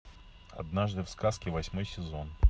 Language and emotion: Russian, neutral